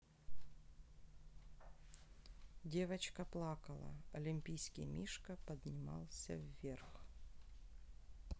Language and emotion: Russian, sad